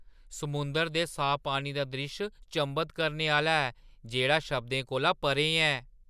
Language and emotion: Dogri, surprised